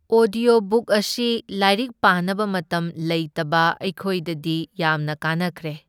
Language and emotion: Manipuri, neutral